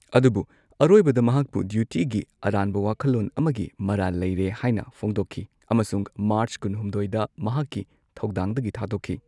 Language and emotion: Manipuri, neutral